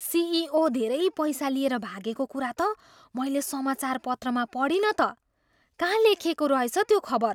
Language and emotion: Nepali, surprised